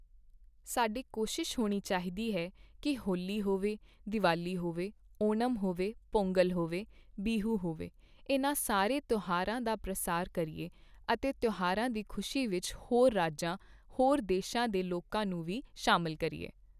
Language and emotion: Punjabi, neutral